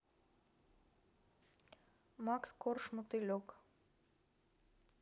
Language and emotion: Russian, neutral